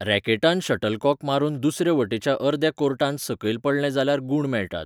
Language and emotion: Goan Konkani, neutral